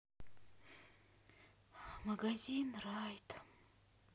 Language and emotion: Russian, sad